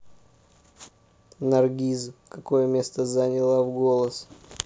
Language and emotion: Russian, neutral